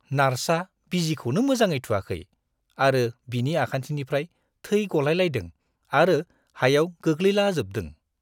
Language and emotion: Bodo, disgusted